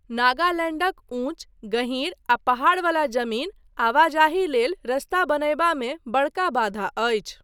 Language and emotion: Maithili, neutral